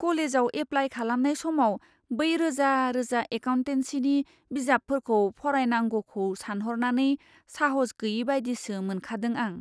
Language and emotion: Bodo, fearful